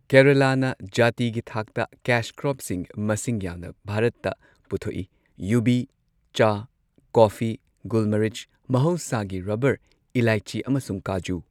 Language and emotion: Manipuri, neutral